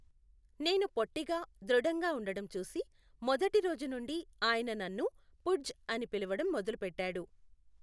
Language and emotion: Telugu, neutral